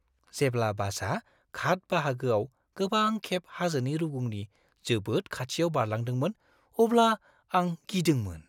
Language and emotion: Bodo, fearful